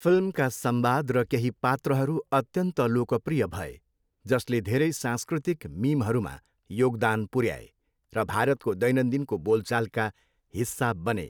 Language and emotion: Nepali, neutral